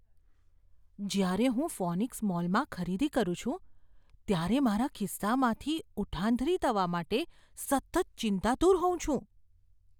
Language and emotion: Gujarati, fearful